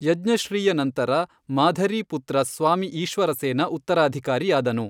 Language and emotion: Kannada, neutral